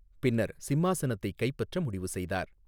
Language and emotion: Tamil, neutral